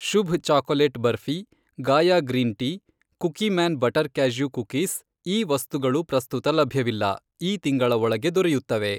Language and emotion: Kannada, neutral